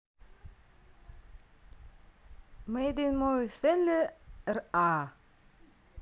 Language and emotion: Russian, neutral